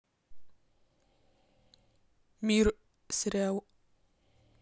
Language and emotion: Russian, neutral